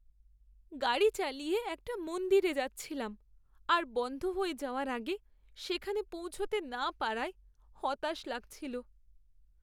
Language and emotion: Bengali, sad